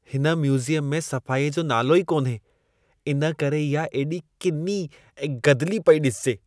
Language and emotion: Sindhi, disgusted